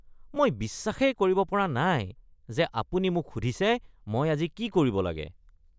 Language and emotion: Assamese, disgusted